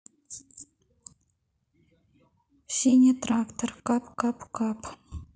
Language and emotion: Russian, sad